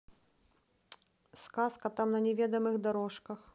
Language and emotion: Russian, neutral